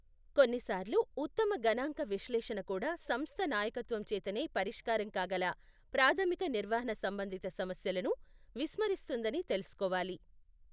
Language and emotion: Telugu, neutral